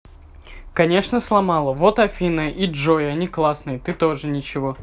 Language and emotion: Russian, positive